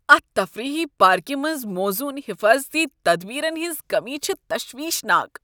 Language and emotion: Kashmiri, disgusted